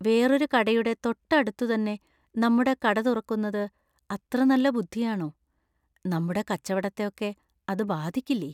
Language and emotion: Malayalam, fearful